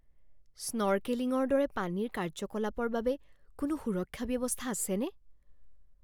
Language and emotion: Assamese, fearful